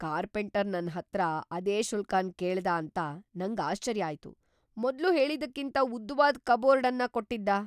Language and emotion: Kannada, surprised